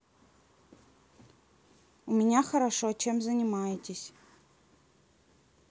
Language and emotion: Russian, neutral